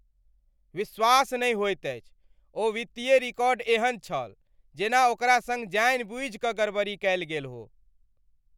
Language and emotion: Maithili, angry